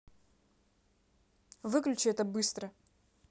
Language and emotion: Russian, angry